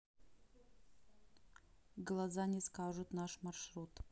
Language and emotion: Russian, neutral